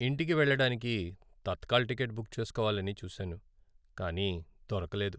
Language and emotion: Telugu, sad